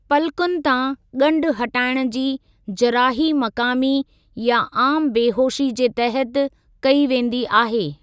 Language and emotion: Sindhi, neutral